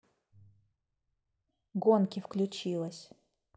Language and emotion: Russian, neutral